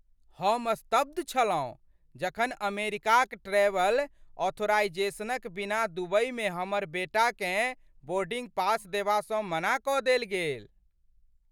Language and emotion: Maithili, surprised